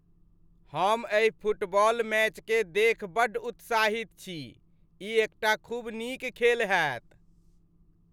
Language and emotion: Maithili, happy